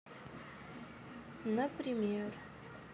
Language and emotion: Russian, sad